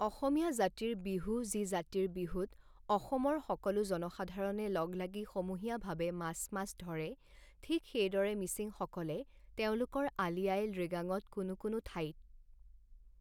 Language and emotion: Assamese, neutral